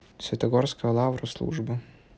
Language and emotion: Russian, neutral